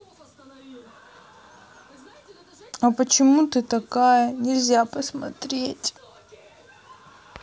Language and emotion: Russian, sad